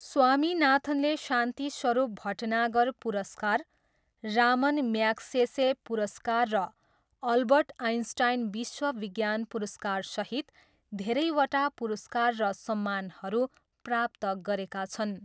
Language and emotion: Nepali, neutral